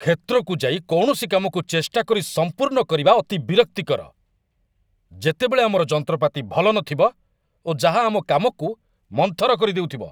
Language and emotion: Odia, angry